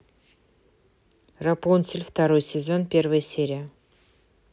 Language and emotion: Russian, neutral